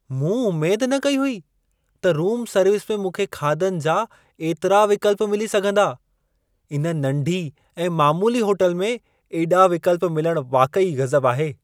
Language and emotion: Sindhi, surprised